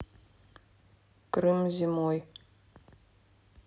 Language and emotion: Russian, neutral